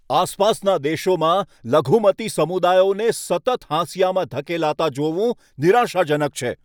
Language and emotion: Gujarati, angry